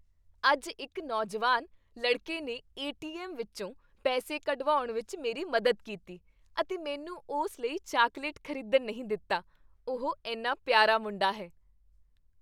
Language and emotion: Punjabi, happy